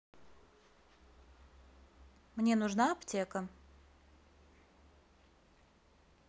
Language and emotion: Russian, neutral